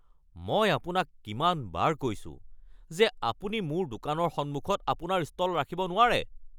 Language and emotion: Assamese, angry